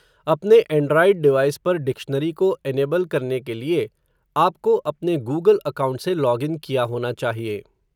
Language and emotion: Hindi, neutral